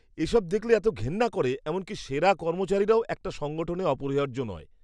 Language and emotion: Bengali, disgusted